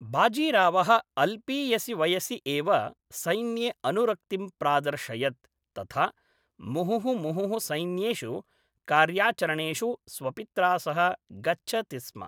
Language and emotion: Sanskrit, neutral